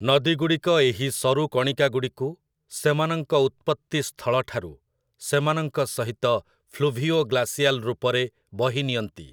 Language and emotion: Odia, neutral